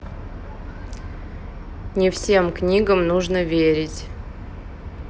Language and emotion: Russian, neutral